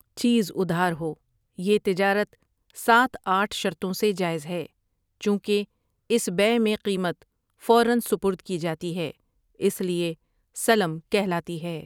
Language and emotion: Urdu, neutral